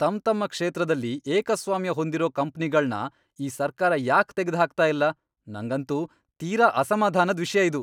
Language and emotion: Kannada, angry